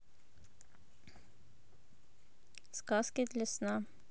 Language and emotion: Russian, neutral